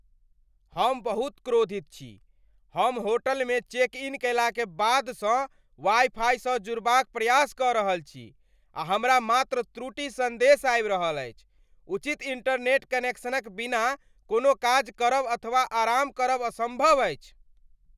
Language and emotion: Maithili, angry